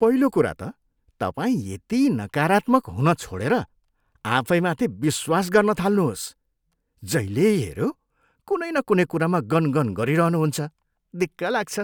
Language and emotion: Nepali, disgusted